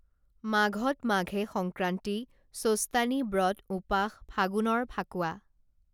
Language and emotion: Assamese, neutral